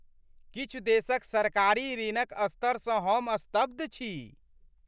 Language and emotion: Maithili, surprised